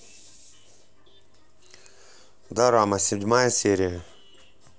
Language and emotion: Russian, neutral